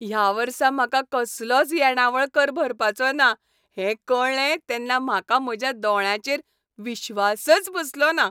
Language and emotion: Goan Konkani, happy